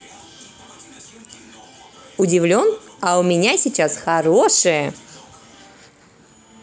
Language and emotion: Russian, positive